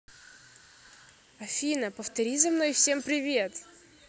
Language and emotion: Russian, neutral